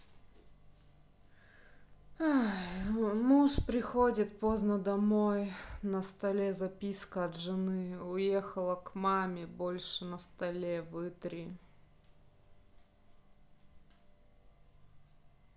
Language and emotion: Russian, sad